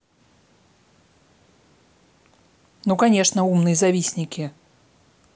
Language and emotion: Russian, angry